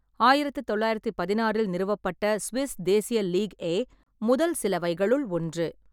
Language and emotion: Tamil, neutral